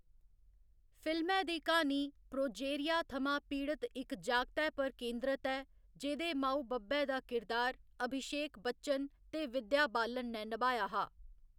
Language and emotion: Dogri, neutral